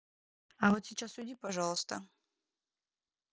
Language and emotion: Russian, neutral